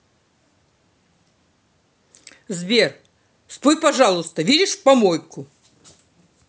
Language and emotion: Russian, angry